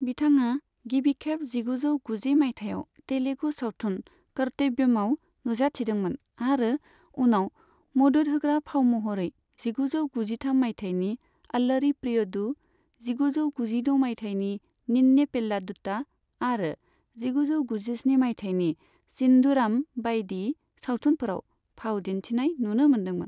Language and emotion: Bodo, neutral